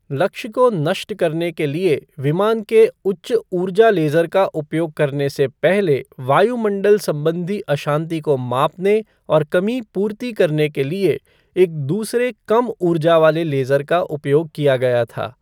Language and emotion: Hindi, neutral